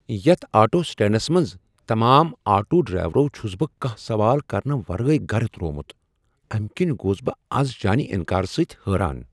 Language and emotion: Kashmiri, surprised